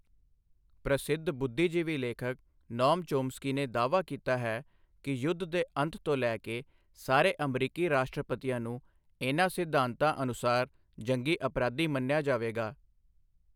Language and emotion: Punjabi, neutral